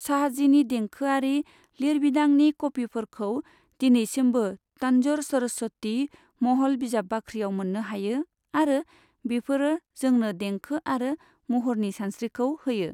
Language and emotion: Bodo, neutral